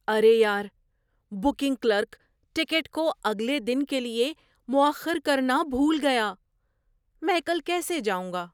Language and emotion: Urdu, surprised